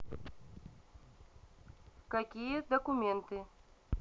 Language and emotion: Russian, neutral